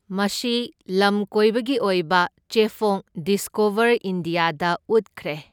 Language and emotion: Manipuri, neutral